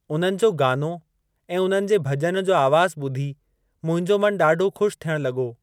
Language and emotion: Sindhi, neutral